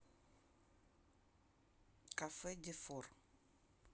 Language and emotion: Russian, neutral